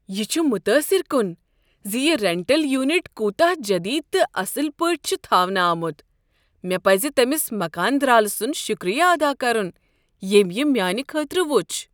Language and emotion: Kashmiri, surprised